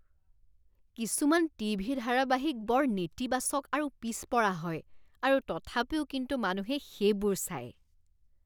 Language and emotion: Assamese, disgusted